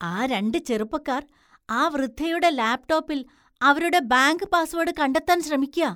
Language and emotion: Malayalam, disgusted